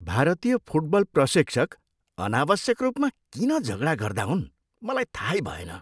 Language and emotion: Nepali, disgusted